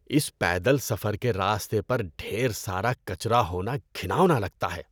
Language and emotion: Urdu, disgusted